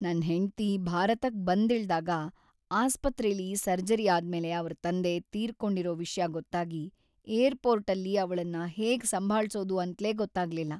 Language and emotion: Kannada, sad